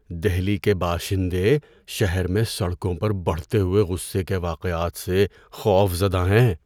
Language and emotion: Urdu, fearful